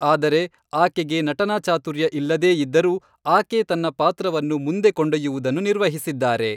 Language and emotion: Kannada, neutral